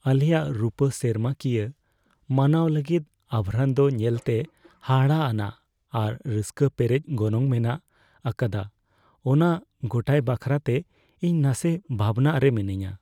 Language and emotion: Santali, fearful